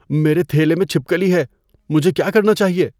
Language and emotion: Urdu, fearful